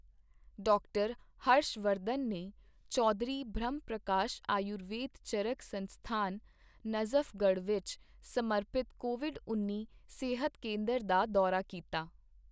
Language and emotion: Punjabi, neutral